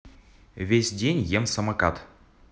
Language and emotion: Russian, neutral